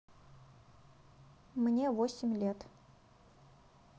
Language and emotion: Russian, neutral